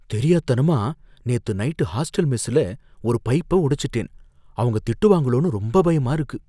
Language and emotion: Tamil, fearful